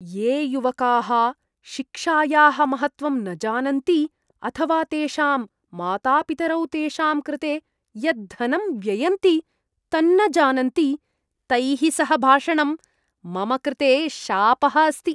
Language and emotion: Sanskrit, disgusted